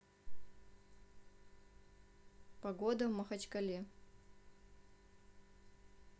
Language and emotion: Russian, neutral